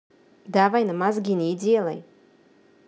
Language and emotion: Russian, angry